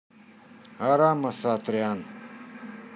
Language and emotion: Russian, neutral